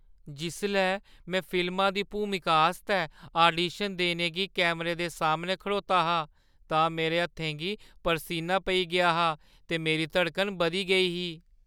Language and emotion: Dogri, fearful